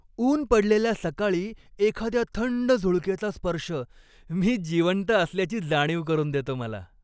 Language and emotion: Marathi, happy